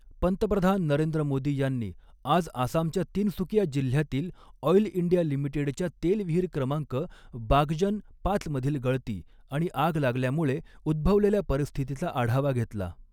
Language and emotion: Marathi, neutral